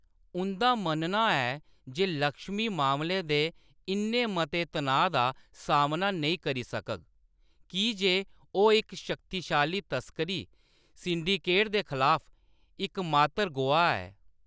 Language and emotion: Dogri, neutral